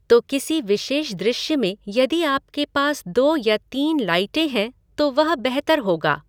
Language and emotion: Hindi, neutral